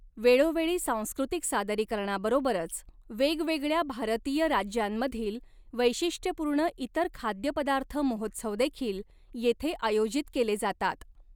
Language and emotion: Marathi, neutral